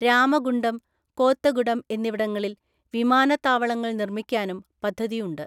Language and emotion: Malayalam, neutral